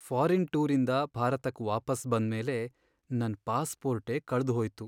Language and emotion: Kannada, sad